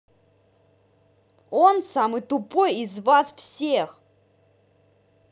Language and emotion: Russian, angry